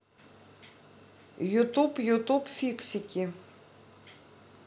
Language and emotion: Russian, neutral